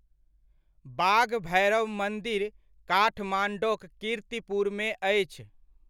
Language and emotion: Maithili, neutral